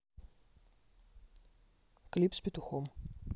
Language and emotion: Russian, neutral